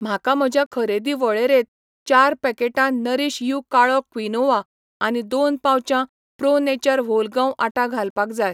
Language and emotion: Goan Konkani, neutral